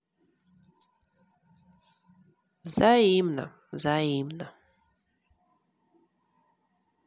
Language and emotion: Russian, sad